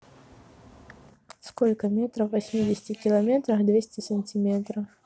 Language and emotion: Russian, neutral